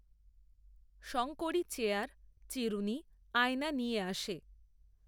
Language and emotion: Bengali, neutral